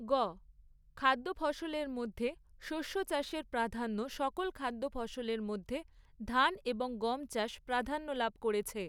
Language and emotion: Bengali, neutral